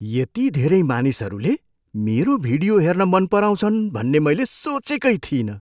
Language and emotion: Nepali, surprised